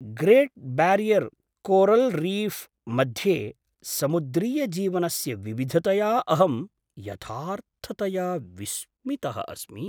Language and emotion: Sanskrit, surprised